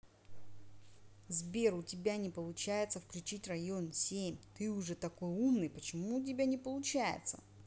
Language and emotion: Russian, angry